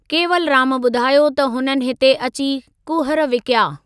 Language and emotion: Sindhi, neutral